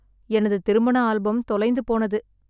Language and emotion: Tamil, sad